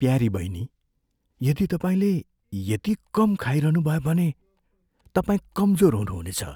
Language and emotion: Nepali, fearful